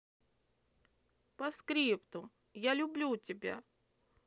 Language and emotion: Russian, angry